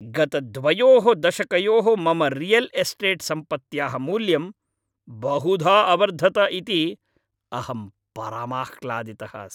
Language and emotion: Sanskrit, happy